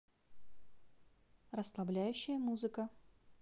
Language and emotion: Russian, neutral